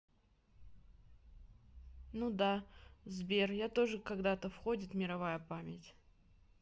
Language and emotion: Russian, neutral